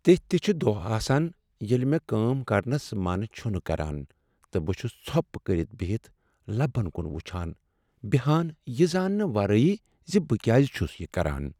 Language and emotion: Kashmiri, sad